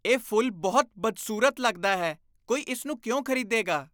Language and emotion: Punjabi, disgusted